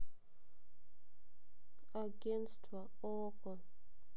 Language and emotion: Russian, sad